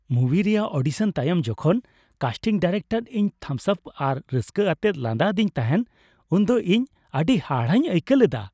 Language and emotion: Santali, happy